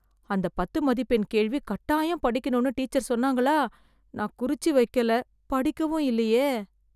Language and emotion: Tamil, fearful